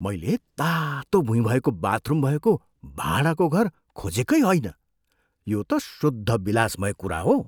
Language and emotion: Nepali, surprised